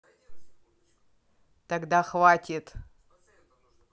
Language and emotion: Russian, angry